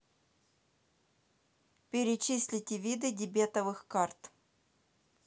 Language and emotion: Russian, neutral